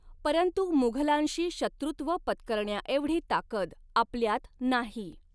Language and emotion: Marathi, neutral